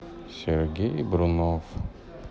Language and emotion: Russian, sad